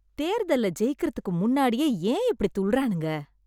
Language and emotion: Tamil, disgusted